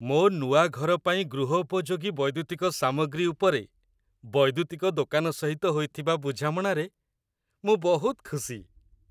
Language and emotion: Odia, happy